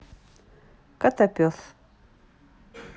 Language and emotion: Russian, neutral